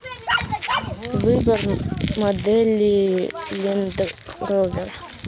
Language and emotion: Russian, neutral